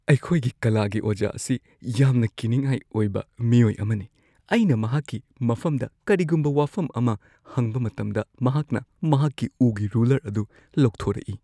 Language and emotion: Manipuri, fearful